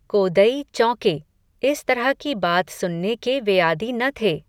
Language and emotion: Hindi, neutral